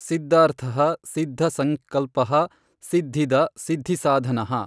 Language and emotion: Kannada, neutral